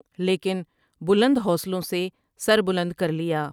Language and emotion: Urdu, neutral